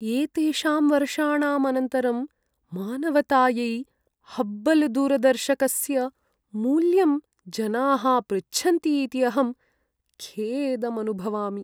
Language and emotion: Sanskrit, sad